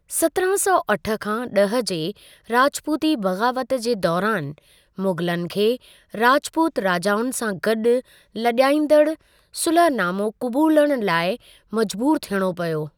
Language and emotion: Sindhi, neutral